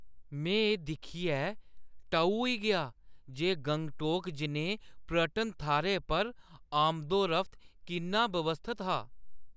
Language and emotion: Dogri, surprised